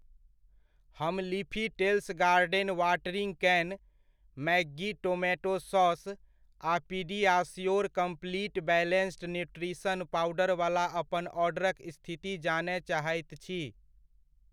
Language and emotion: Maithili, neutral